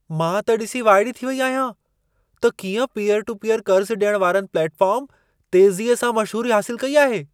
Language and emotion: Sindhi, surprised